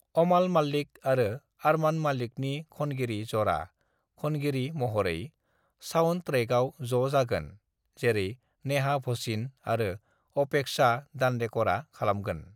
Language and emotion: Bodo, neutral